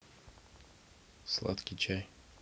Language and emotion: Russian, neutral